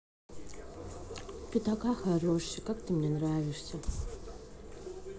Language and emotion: Russian, neutral